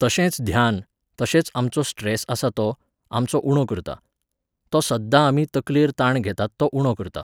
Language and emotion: Goan Konkani, neutral